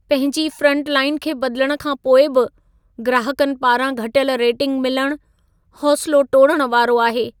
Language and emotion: Sindhi, sad